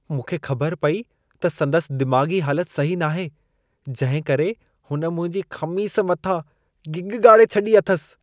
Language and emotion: Sindhi, disgusted